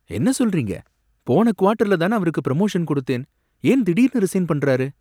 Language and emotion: Tamil, surprised